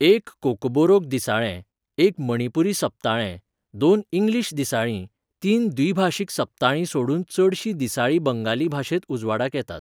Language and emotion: Goan Konkani, neutral